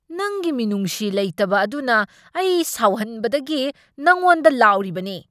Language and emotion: Manipuri, angry